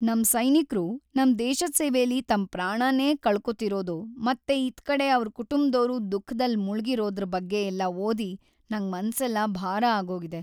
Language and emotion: Kannada, sad